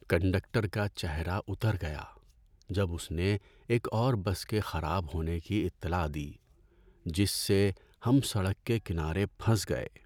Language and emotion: Urdu, sad